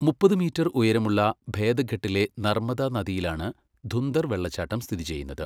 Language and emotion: Malayalam, neutral